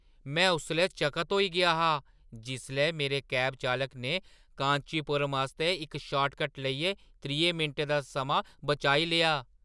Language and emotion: Dogri, surprised